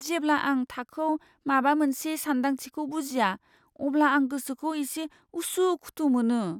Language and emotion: Bodo, fearful